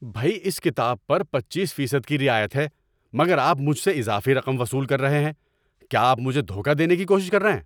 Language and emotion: Urdu, angry